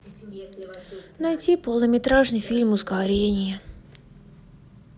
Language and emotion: Russian, sad